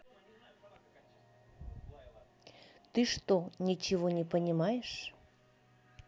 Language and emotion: Russian, neutral